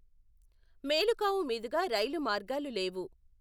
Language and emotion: Telugu, neutral